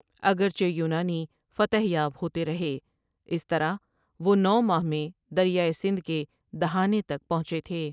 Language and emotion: Urdu, neutral